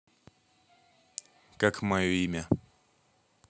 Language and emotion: Russian, neutral